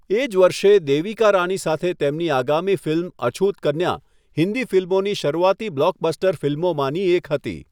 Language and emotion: Gujarati, neutral